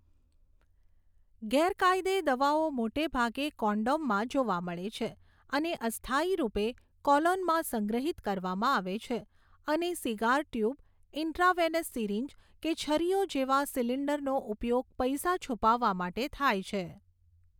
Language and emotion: Gujarati, neutral